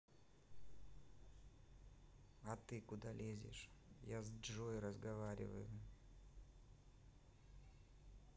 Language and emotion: Russian, sad